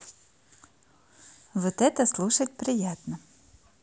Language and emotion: Russian, positive